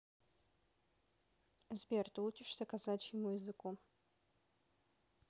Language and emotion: Russian, neutral